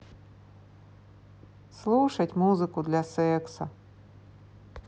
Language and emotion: Russian, neutral